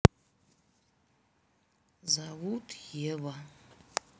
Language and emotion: Russian, sad